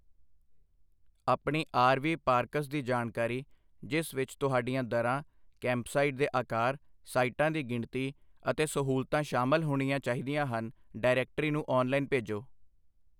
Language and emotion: Punjabi, neutral